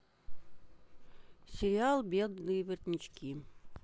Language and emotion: Russian, sad